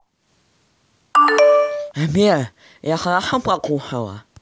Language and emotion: Russian, neutral